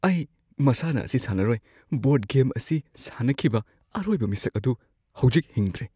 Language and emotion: Manipuri, fearful